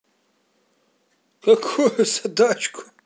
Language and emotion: Russian, positive